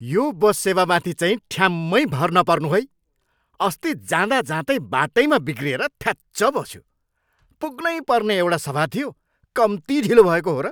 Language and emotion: Nepali, angry